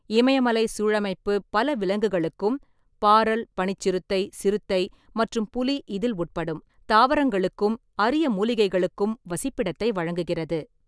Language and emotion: Tamil, neutral